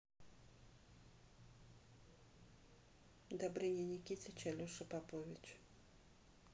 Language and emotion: Russian, neutral